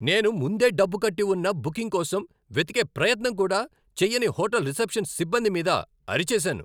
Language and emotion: Telugu, angry